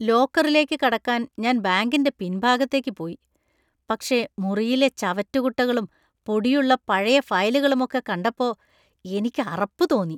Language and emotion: Malayalam, disgusted